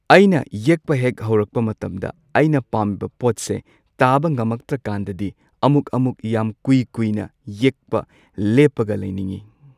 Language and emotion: Manipuri, neutral